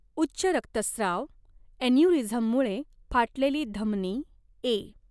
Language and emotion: Marathi, neutral